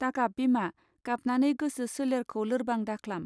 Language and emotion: Bodo, neutral